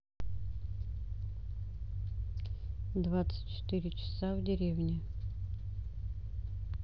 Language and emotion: Russian, neutral